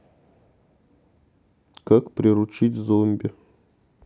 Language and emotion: Russian, neutral